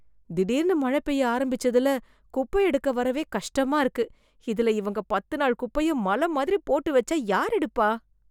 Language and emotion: Tamil, disgusted